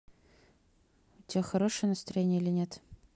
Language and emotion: Russian, neutral